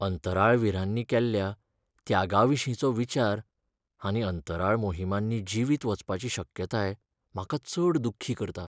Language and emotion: Goan Konkani, sad